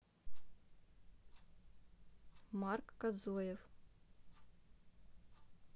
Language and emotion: Russian, neutral